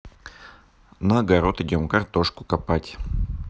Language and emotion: Russian, neutral